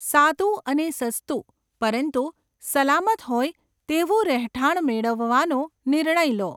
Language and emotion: Gujarati, neutral